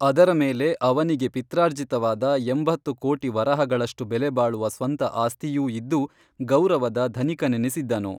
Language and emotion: Kannada, neutral